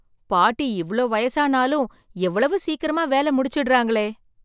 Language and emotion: Tamil, surprised